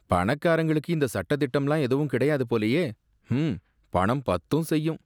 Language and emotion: Tamil, disgusted